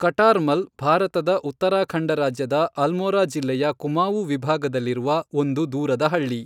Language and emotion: Kannada, neutral